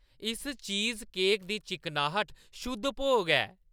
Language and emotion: Dogri, happy